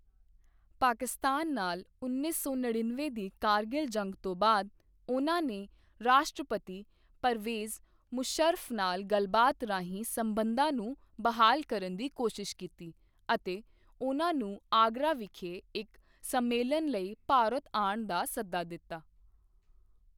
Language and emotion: Punjabi, neutral